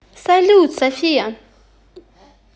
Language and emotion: Russian, positive